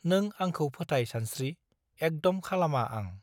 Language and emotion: Bodo, neutral